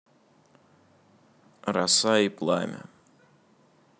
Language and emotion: Russian, neutral